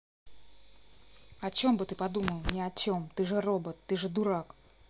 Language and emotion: Russian, angry